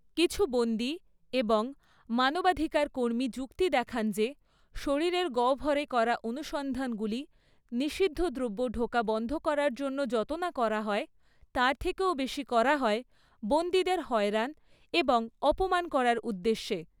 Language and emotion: Bengali, neutral